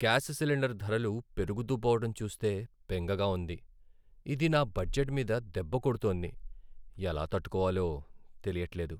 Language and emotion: Telugu, sad